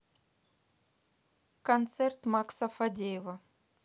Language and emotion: Russian, neutral